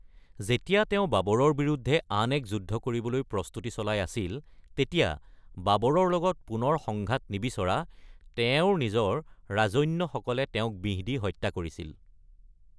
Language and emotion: Assamese, neutral